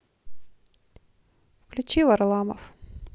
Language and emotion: Russian, neutral